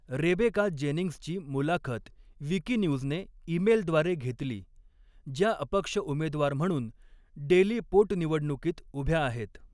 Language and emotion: Marathi, neutral